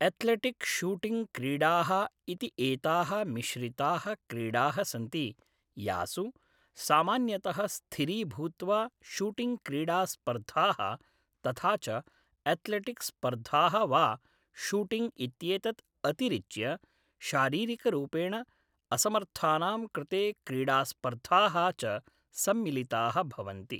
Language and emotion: Sanskrit, neutral